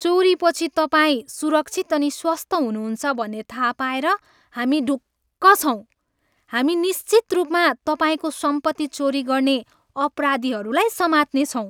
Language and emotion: Nepali, happy